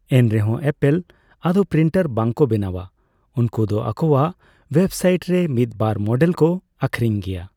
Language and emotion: Santali, neutral